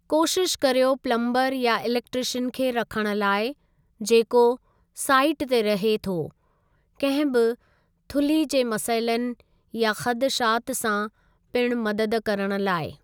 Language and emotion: Sindhi, neutral